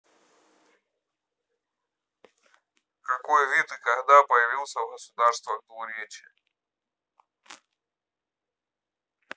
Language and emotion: Russian, neutral